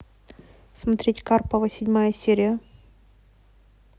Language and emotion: Russian, neutral